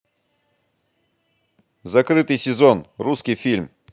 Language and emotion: Russian, positive